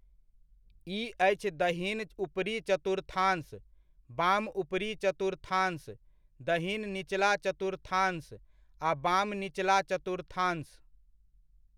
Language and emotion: Maithili, neutral